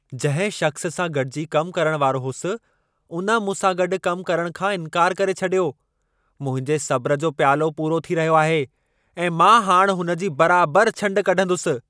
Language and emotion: Sindhi, angry